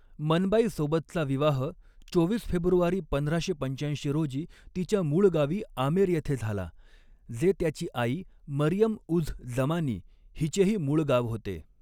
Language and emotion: Marathi, neutral